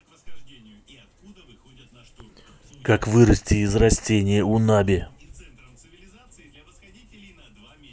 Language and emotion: Russian, neutral